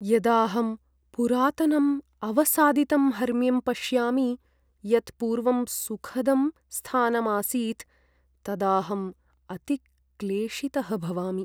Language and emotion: Sanskrit, sad